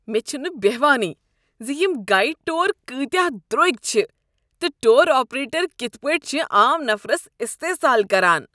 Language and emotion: Kashmiri, disgusted